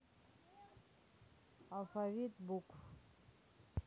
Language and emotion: Russian, neutral